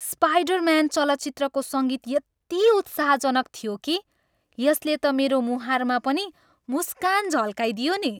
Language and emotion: Nepali, happy